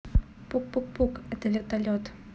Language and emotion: Russian, neutral